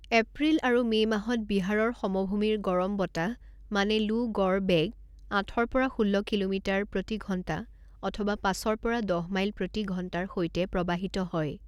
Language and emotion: Assamese, neutral